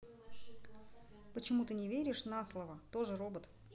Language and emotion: Russian, neutral